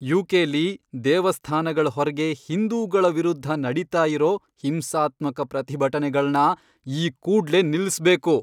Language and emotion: Kannada, angry